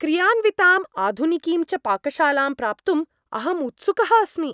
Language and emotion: Sanskrit, happy